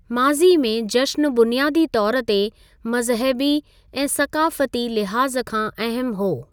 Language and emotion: Sindhi, neutral